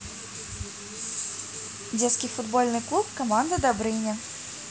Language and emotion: Russian, positive